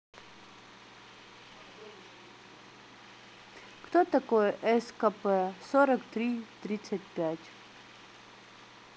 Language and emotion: Russian, neutral